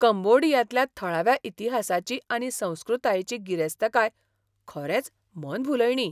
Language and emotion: Goan Konkani, surprised